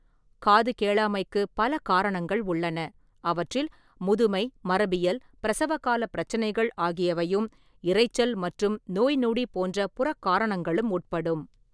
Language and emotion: Tamil, neutral